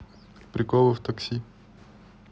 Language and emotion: Russian, neutral